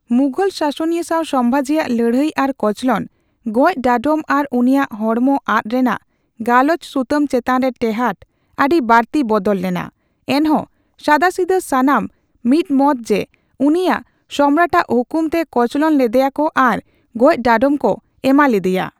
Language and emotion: Santali, neutral